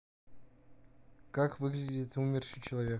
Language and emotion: Russian, neutral